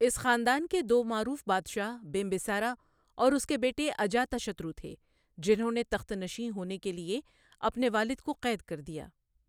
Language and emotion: Urdu, neutral